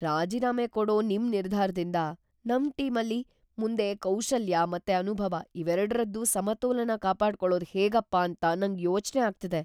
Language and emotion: Kannada, fearful